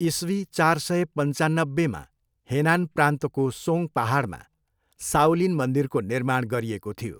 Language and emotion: Nepali, neutral